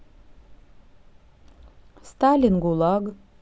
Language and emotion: Russian, neutral